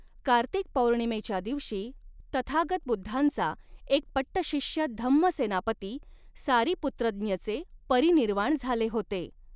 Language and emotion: Marathi, neutral